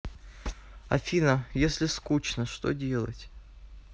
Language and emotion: Russian, sad